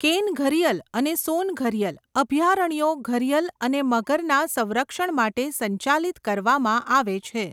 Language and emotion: Gujarati, neutral